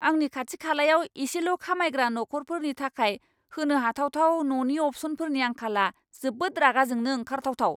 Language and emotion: Bodo, angry